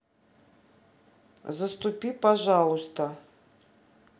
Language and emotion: Russian, neutral